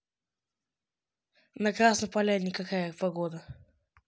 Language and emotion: Russian, neutral